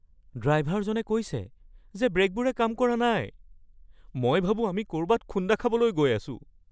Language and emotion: Assamese, fearful